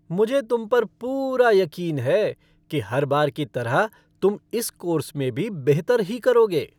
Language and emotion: Hindi, happy